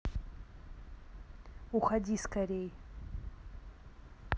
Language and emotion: Russian, neutral